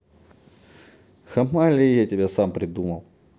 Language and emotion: Russian, neutral